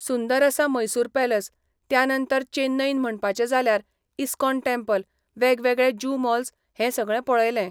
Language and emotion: Goan Konkani, neutral